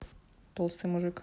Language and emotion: Russian, neutral